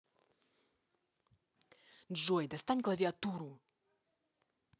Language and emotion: Russian, angry